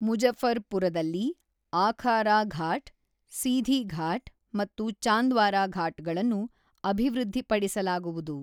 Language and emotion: Kannada, neutral